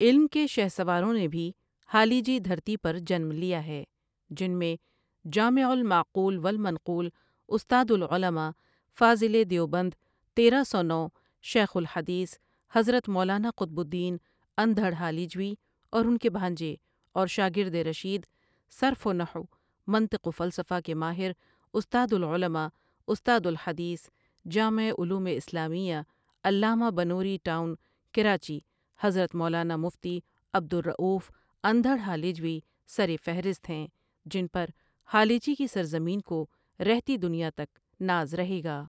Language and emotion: Urdu, neutral